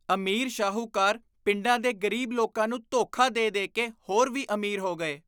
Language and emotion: Punjabi, disgusted